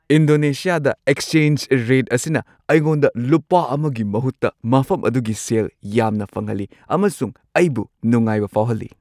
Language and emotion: Manipuri, happy